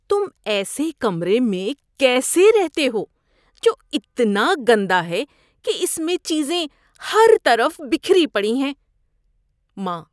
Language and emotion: Urdu, disgusted